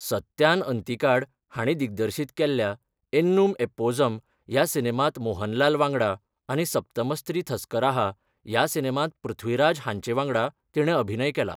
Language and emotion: Goan Konkani, neutral